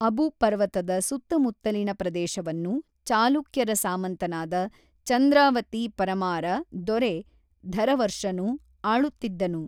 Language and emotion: Kannada, neutral